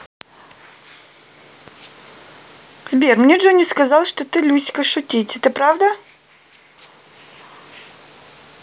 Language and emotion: Russian, neutral